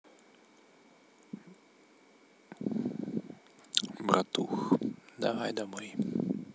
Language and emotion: Russian, neutral